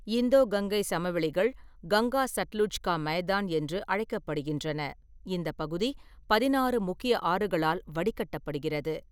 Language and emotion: Tamil, neutral